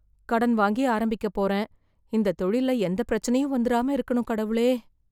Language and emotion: Tamil, fearful